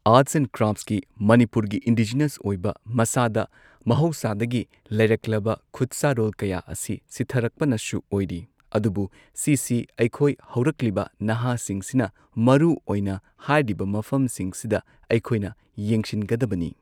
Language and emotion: Manipuri, neutral